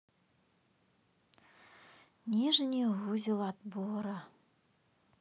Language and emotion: Russian, sad